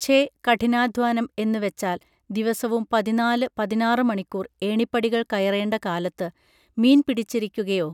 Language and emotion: Malayalam, neutral